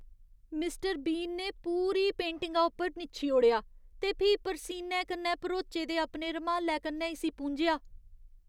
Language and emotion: Dogri, disgusted